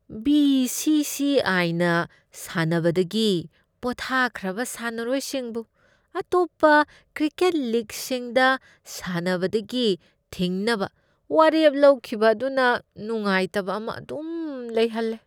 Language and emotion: Manipuri, disgusted